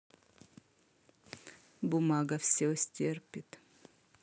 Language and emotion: Russian, neutral